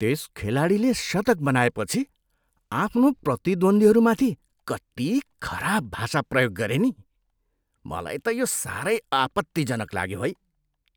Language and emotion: Nepali, disgusted